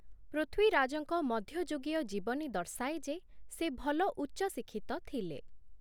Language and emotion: Odia, neutral